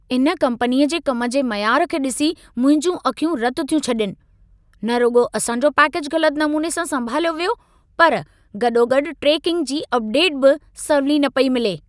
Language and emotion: Sindhi, angry